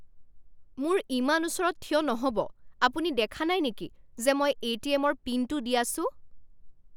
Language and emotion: Assamese, angry